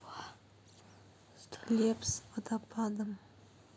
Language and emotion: Russian, neutral